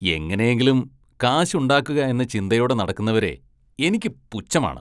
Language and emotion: Malayalam, disgusted